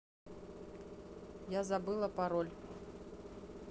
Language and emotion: Russian, neutral